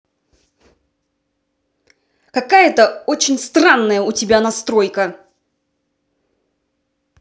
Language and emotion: Russian, angry